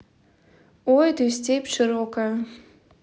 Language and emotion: Russian, neutral